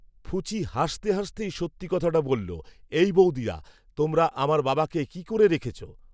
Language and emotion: Bengali, neutral